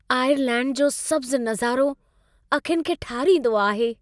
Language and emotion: Sindhi, happy